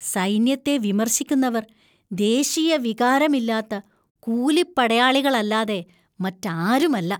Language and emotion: Malayalam, disgusted